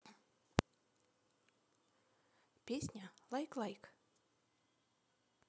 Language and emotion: Russian, neutral